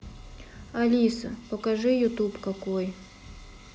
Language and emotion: Russian, neutral